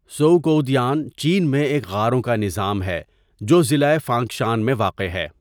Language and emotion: Urdu, neutral